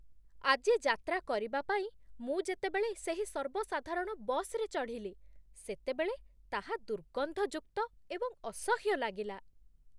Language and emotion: Odia, disgusted